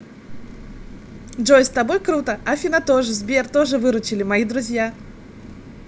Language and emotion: Russian, positive